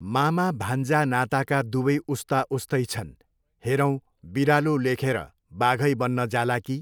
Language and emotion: Nepali, neutral